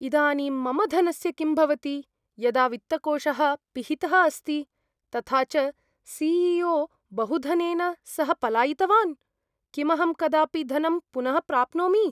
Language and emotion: Sanskrit, fearful